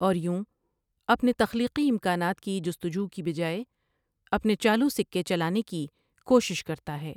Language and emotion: Urdu, neutral